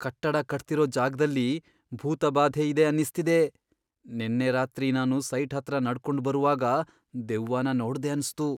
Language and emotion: Kannada, fearful